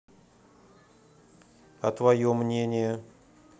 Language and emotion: Russian, neutral